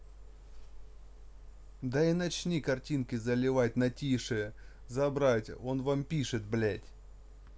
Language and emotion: Russian, angry